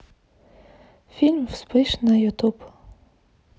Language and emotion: Russian, neutral